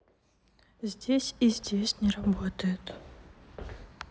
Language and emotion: Russian, sad